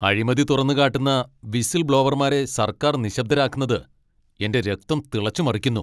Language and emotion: Malayalam, angry